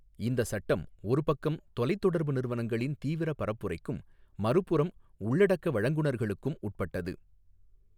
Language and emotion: Tamil, neutral